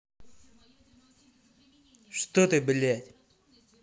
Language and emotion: Russian, angry